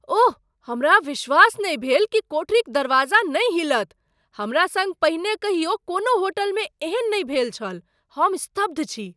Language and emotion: Maithili, surprised